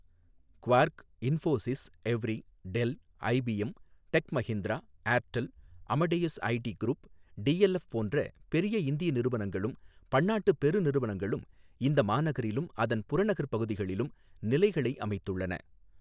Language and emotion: Tamil, neutral